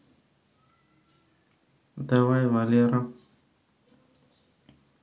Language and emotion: Russian, neutral